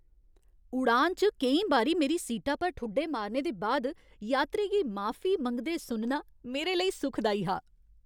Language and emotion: Dogri, happy